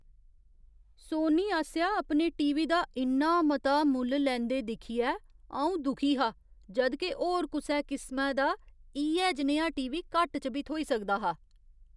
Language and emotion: Dogri, disgusted